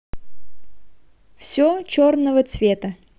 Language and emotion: Russian, positive